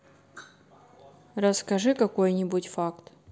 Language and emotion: Russian, neutral